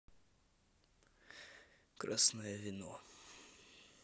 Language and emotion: Russian, neutral